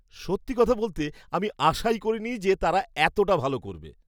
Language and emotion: Bengali, surprised